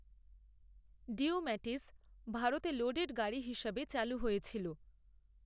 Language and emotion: Bengali, neutral